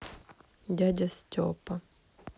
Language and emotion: Russian, sad